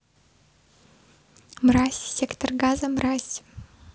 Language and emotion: Russian, neutral